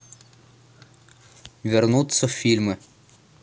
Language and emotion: Russian, neutral